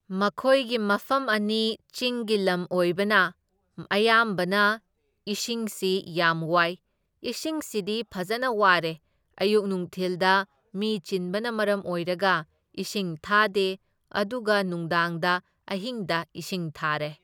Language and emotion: Manipuri, neutral